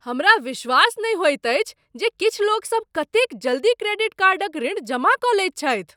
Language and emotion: Maithili, surprised